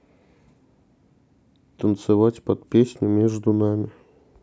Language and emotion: Russian, sad